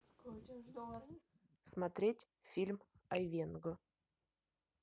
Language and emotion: Russian, neutral